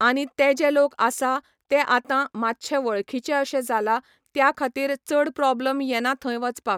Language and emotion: Goan Konkani, neutral